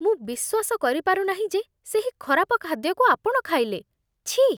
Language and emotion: Odia, disgusted